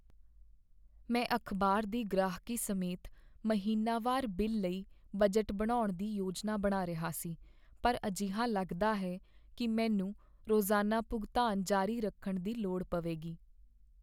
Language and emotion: Punjabi, sad